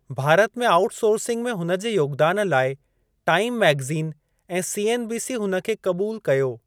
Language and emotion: Sindhi, neutral